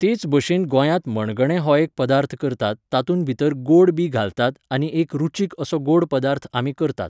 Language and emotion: Goan Konkani, neutral